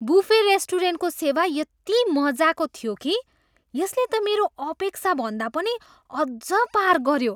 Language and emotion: Nepali, surprised